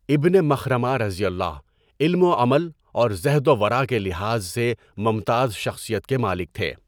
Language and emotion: Urdu, neutral